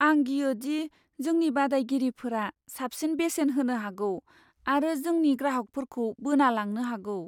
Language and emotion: Bodo, fearful